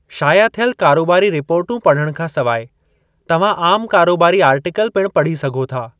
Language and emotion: Sindhi, neutral